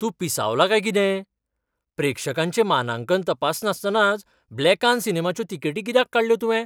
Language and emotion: Goan Konkani, surprised